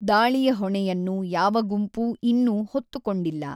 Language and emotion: Kannada, neutral